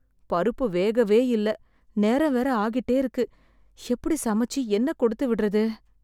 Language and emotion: Tamil, sad